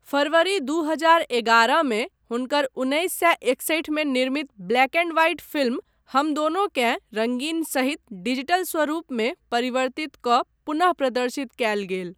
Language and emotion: Maithili, neutral